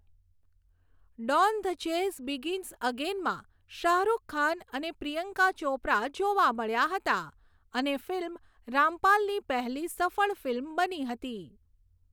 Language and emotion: Gujarati, neutral